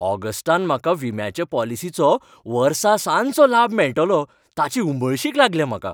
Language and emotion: Goan Konkani, happy